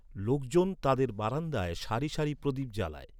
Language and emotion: Bengali, neutral